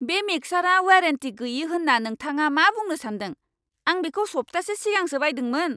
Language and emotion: Bodo, angry